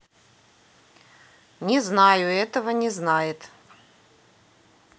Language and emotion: Russian, neutral